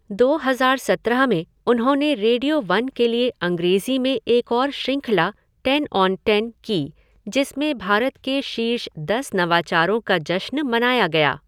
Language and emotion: Hindi, neutral